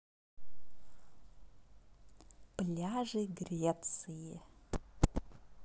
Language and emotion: Russian, positive